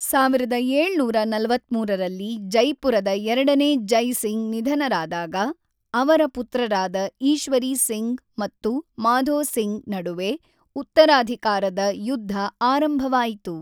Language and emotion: Kannada, neutral